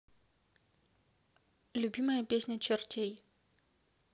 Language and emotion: Russian, neutral